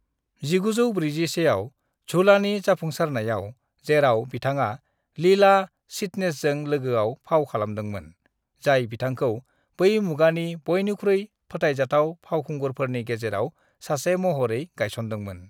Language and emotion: Bodo, neutral